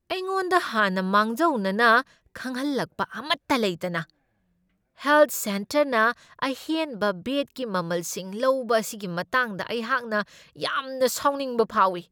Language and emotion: Manipuri, angry